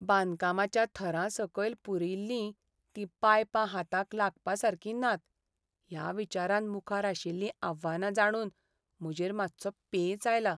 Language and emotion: Goan Konkani, sad